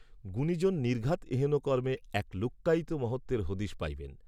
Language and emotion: Bengali, neutral